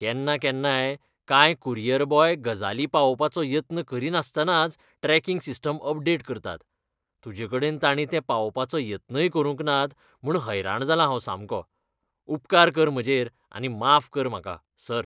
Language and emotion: Goan Konkani, disgusted